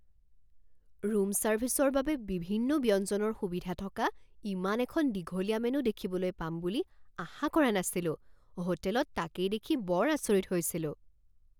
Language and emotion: Assamese, surprised